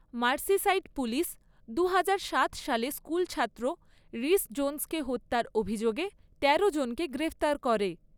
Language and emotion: Bengali, neutral